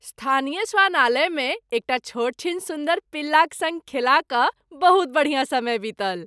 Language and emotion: Maithili, happy